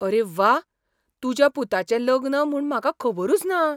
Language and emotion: Goan Konkani, surprised